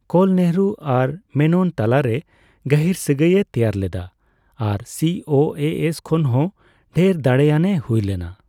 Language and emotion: Santali, neutral